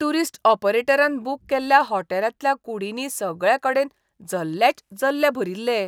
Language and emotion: Goan Konkani, disgusted